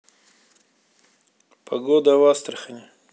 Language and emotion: Russian, neutral